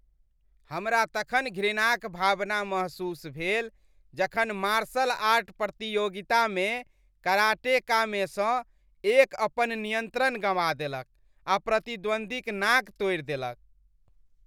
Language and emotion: Maithili, disgusted